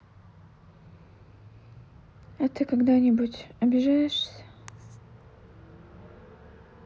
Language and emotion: Russian, sad